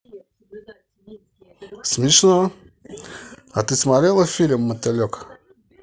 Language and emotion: Russian, positive